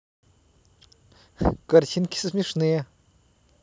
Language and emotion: Russian, positive